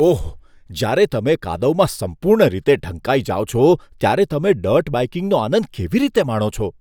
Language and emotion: Gujarati, disgusted